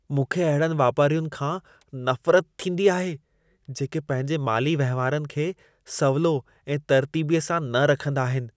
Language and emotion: Sindhi, disgusted